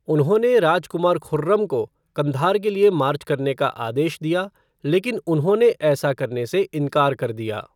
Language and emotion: Hindi, neutral